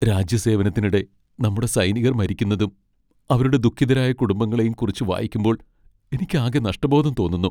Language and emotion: Malayalam, sad